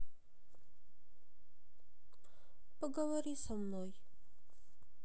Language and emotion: Russian, sad